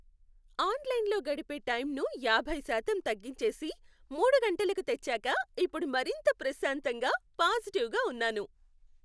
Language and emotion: Telugu, happy